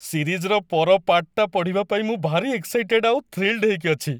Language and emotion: Odia, happy